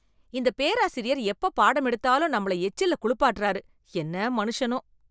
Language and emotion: Tamil, disgusted